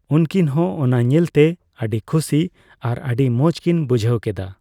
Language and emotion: Santali, neutral